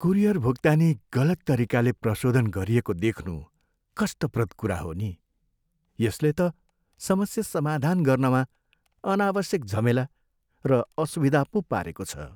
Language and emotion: Nepali, sad